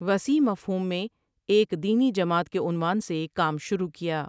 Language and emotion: Urdu, neutral